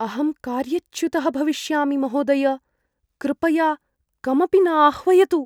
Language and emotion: Sanskrit, fearful